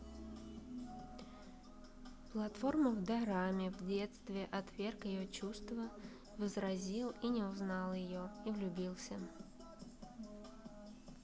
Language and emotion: Russian, neutral